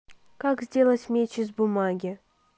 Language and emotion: Russian, neutral